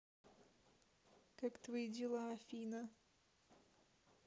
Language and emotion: Russian, neutral